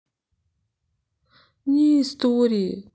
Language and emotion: Russian, sad